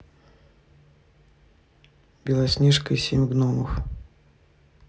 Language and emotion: Russian, neutral